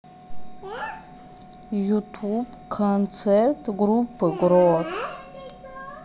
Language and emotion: Russian, neutral